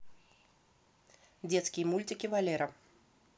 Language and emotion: Russian, neutral